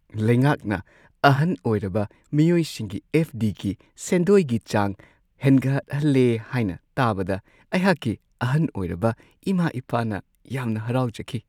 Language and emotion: Manipuri, happy